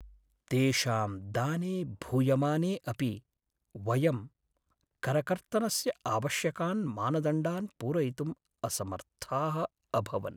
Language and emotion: Sanskrit, sad